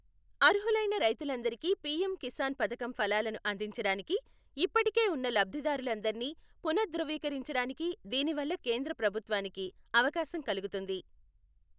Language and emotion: Telugu, neutral